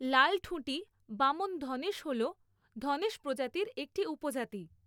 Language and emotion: Bengali, neutral